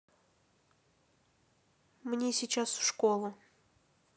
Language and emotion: Russian, neutral